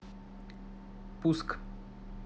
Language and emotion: Russian, neutral